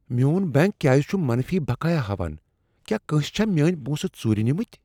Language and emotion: Kashmiri, fearful